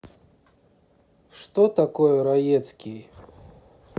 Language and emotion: Russian, neutral